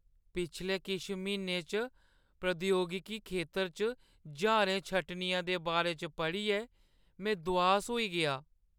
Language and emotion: Dogri, sad